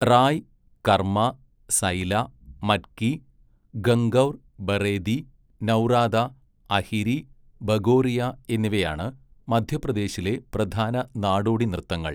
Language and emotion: Malayalam, neutral